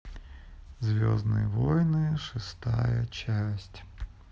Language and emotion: Russian, sad